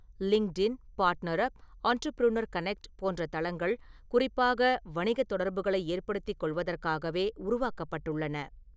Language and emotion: Tamil, neutral